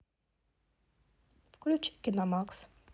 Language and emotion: Russian, neutral